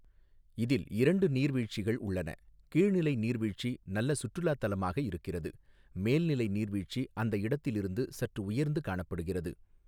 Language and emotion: Tamil, neutral